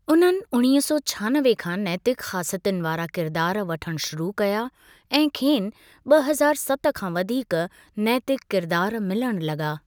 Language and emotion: Sindhi, neutral